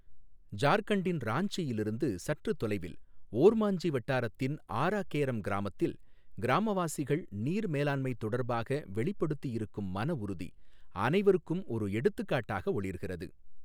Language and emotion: Tamil, neutral